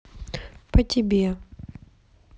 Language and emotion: Russian, sad